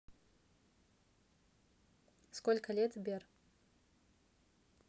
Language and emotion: Russian, neutral